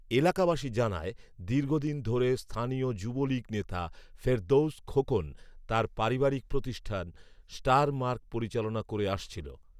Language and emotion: Bengali, neutral